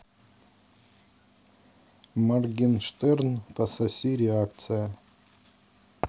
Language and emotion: Russian, neutral